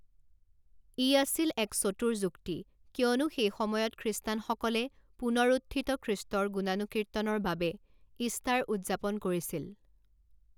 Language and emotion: Assamese, neutral